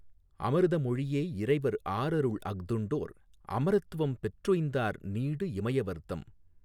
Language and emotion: Tamil, neutral